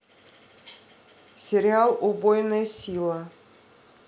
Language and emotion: Russian, neutral